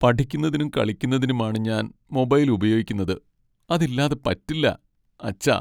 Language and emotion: Malayalam, sad